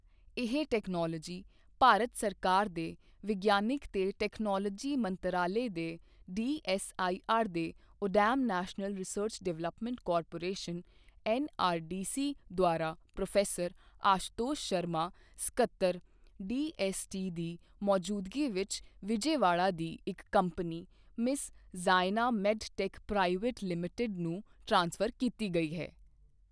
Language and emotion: Punjabi, neutral